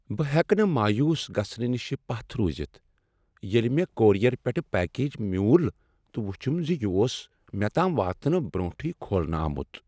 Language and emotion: Kashmiri, sad